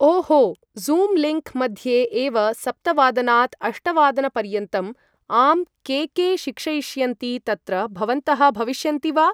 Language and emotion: Sanskrit, neutral